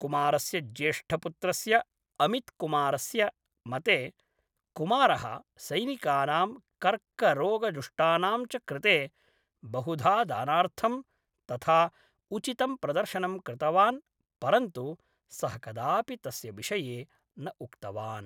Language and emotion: Sanskrit, neutral